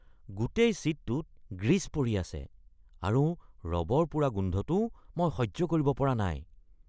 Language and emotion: Assamese, disgusted